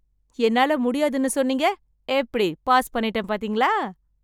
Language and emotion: Tamil, happy